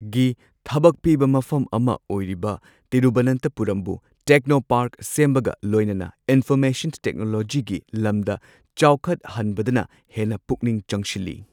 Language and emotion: Manipuri, neutral